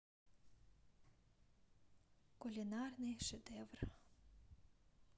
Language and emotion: Russian, neutral